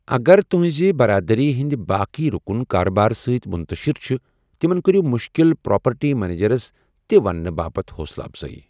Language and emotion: Kashmiri, neutral